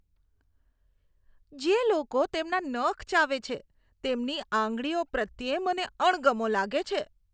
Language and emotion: Gujarati, disgusted